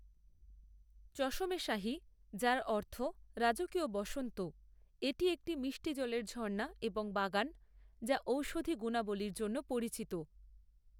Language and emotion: Bengali, neutral